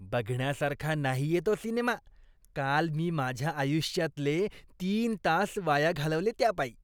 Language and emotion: Marathi, disgusted